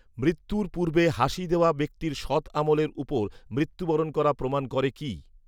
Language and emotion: Bengali, neutral